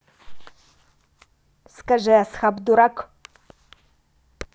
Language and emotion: Russian, neutral